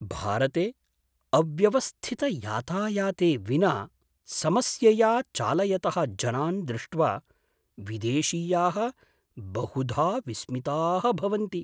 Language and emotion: Sanskrit, surprised